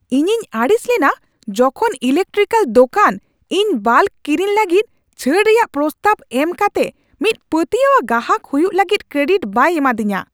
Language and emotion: Santali, angry